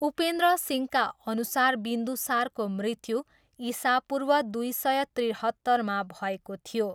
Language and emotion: Nepali, neutral